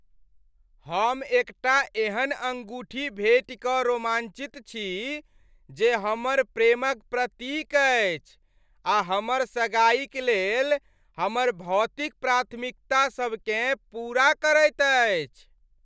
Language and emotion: Maithili, happy